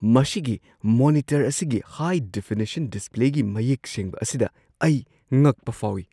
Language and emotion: Manipuri, surprised